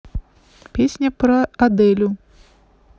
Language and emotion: Russian, neutral